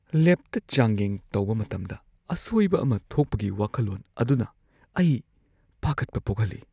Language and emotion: Manipuri, fearful